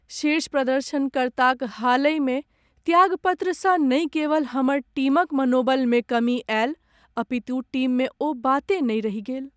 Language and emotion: Maithili, sad